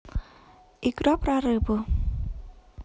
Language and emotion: Russian, neutral